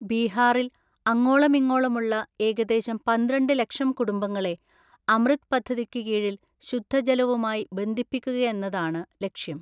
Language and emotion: Malayalam, neutral